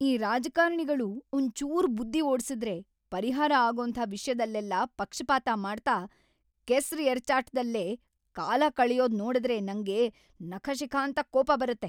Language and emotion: Kannada, angry